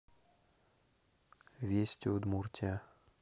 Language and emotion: Russian, neutral